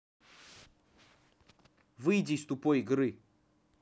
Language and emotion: Russian, angry